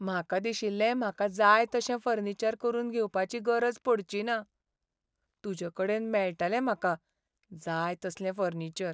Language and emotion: Goan Konkani, sad